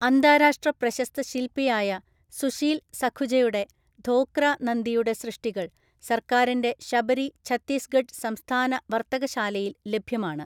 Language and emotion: Malayalam, neutral